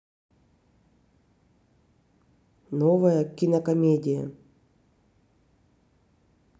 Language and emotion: Russian, neutral